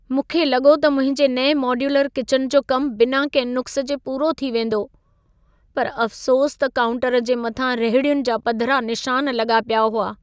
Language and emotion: Sindhi, sad